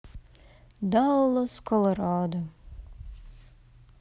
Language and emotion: Russian, neutral